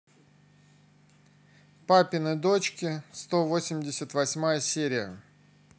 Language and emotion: Russian, neutral